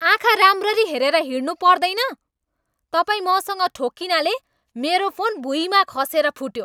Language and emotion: Nepali, angry